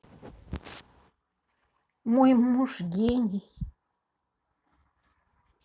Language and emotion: Russian, neutral